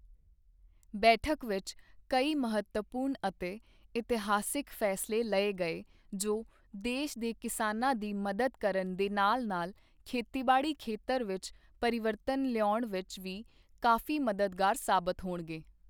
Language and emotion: Punjabi, neutral